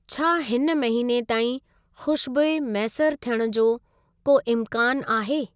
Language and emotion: Sindhi, neutral